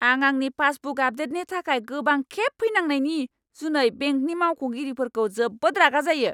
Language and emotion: Bodo, angry